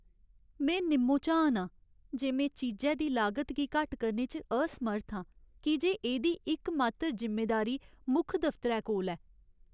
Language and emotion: Dogri, sad